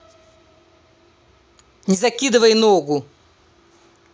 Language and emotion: Russian, angry